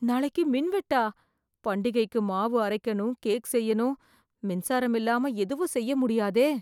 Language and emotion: Tamil, fearful